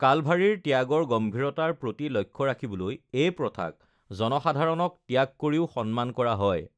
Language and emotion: Assamese, neutral